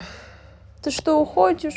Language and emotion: Russian, sad